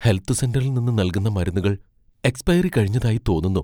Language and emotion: Malayalam, fearful